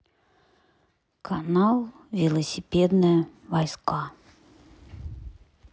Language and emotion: Russian, neutral